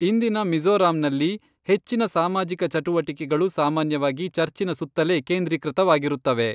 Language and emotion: Kannada, neutral